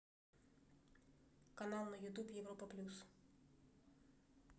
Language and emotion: Russian, neutral